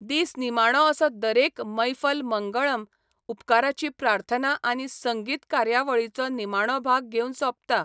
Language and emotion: Goan Konkani, neutral